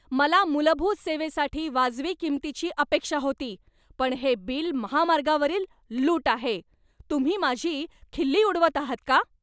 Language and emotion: Marathi, angry